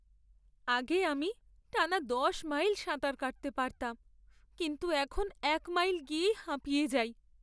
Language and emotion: Bengali, sad